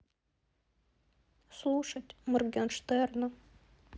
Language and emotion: Russian, sad